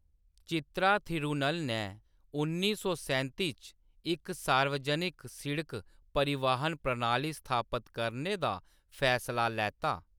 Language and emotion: Dogri, neutral